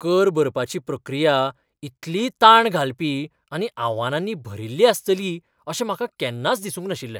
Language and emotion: Goan Konkani, surprised